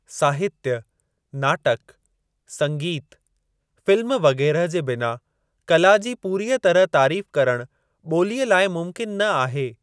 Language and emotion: Sindhi, neutral